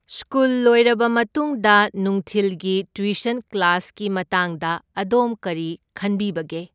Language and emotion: Manipuri, neutral